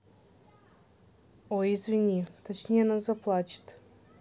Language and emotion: Russian, neutral